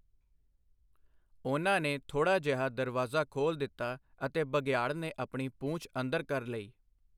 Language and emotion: Punjabi, neutral